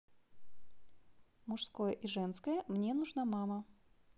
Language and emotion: Russian, neutral